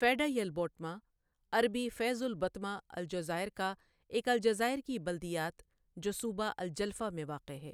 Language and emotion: Urdu, neutral